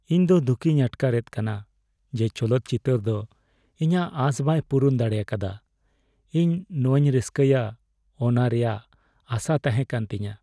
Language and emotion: Santali, sad